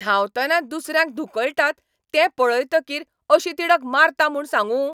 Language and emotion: Goan Konkani, angry